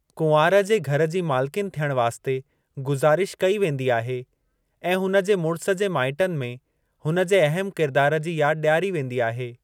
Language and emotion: Sindhi, neutral